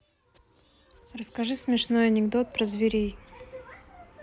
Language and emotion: Russian, neutral